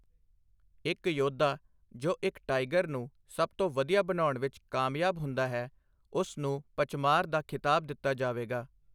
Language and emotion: Punjabi, neutral